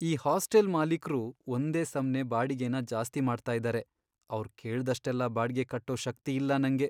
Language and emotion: Kannada, sad